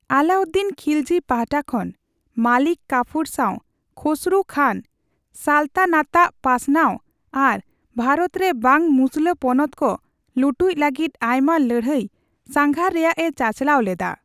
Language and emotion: Santali, neutral